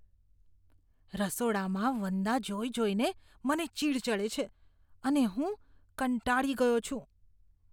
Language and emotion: Gujarati, disgusted